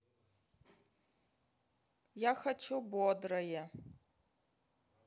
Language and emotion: Russian, sad